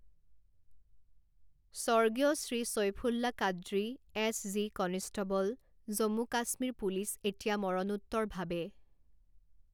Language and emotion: Assamese, neutral